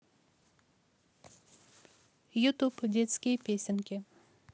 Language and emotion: Russian, neutral